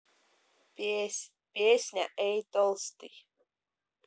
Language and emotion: Russian, neutral